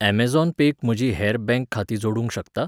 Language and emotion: Goan Konkani, neutral